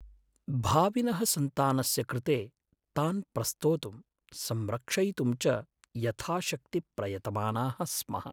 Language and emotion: Sanskrit, sad